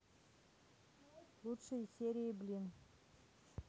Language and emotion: Russian, neutral